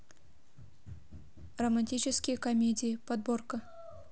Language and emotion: Russian, neutral